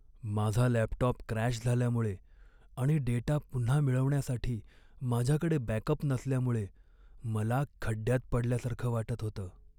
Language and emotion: Marathi, sad